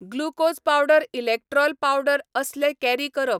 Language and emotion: Goan Konkani, neutral